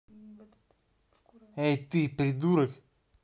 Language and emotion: Russian, angry